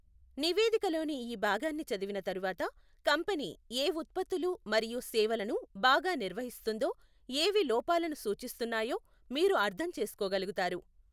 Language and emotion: Telugu, neutral